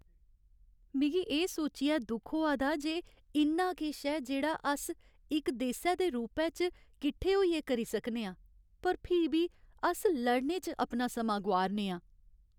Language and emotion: Dogri, sad